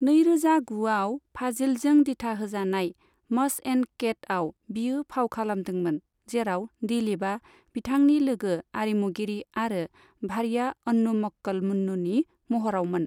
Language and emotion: Bodo, neutral